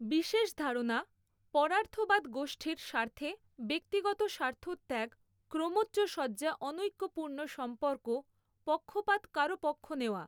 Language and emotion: Bengali, neutral